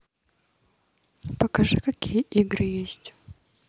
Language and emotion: Russian, neutral